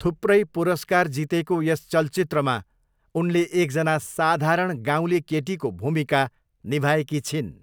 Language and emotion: Nepali, neutral